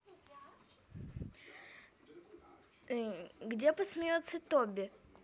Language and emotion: Russian, neutral